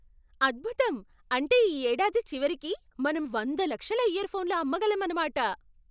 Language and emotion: Telugu, surprised